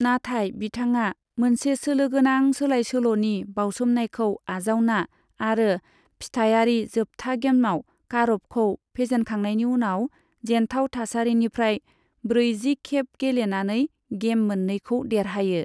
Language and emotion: Bodo, neutral